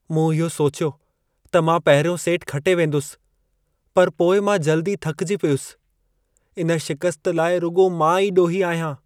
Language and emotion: Sindhi, sad